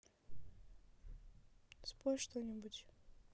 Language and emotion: Russian, sad